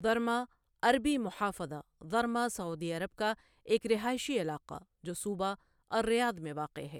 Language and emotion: Urdu, neutral